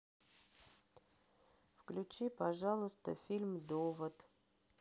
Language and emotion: Russian, sad